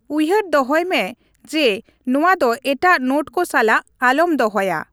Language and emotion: Santali, neutral